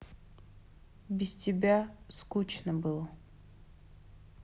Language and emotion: Russian, sad